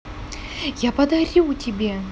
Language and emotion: Russian, positive